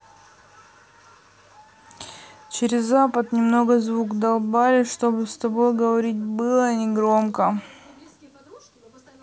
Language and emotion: Russian, neutral